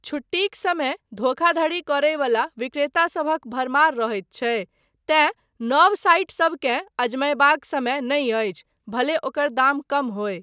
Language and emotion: Maithili, neutral